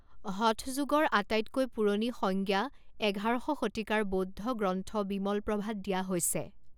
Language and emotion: Assamese, neutral